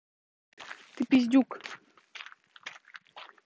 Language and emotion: Russian, angry